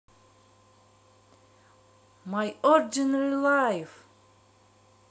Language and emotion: Russian, positive